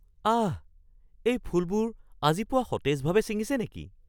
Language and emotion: Assamese, surprised